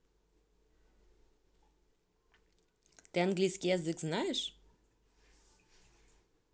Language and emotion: Russian, neutral